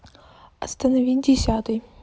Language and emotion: Russian, neutral